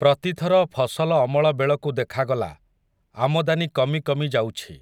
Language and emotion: Odia, neutral